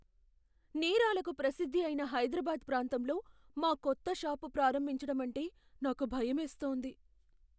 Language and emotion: Telugu, fearful